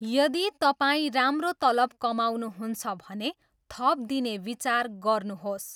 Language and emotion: Nepali, neutral